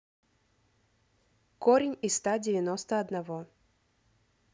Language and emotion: Russian, neutral